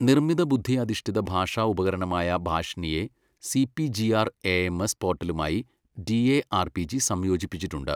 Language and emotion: Malayalam, neutral